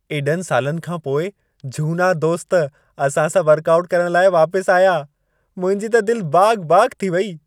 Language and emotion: Sindhi, happy